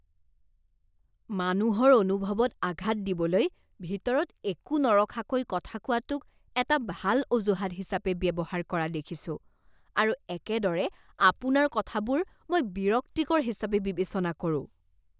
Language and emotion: Assamese, disgusted